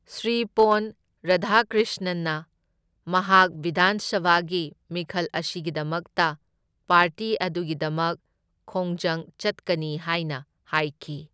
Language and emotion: Manipuri, neutral